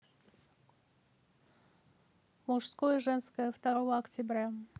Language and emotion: Russian, neutral